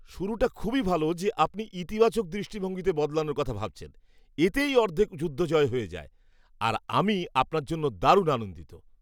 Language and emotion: Bengali, happy